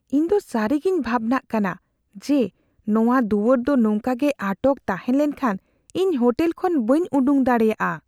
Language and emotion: Santali, fearful